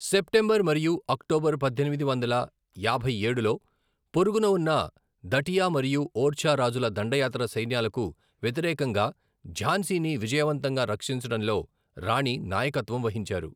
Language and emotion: Telugu, neutral